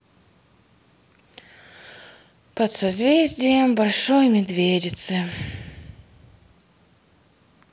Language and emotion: Russian, sad